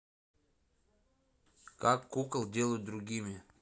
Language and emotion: Russian, neutral